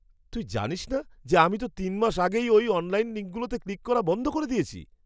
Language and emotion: Bengali, surprised